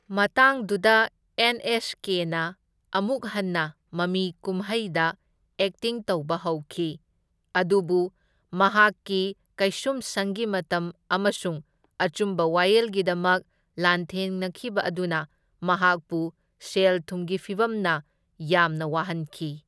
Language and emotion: Manipuri, neutral